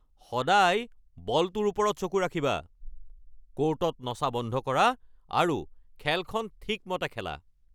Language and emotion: Assamese, angry